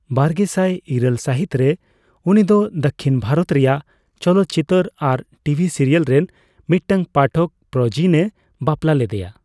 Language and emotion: Santali, neutral